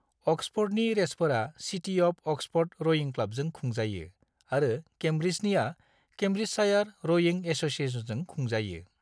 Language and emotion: Bodo, neutral